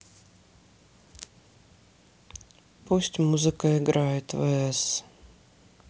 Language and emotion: Russian, sad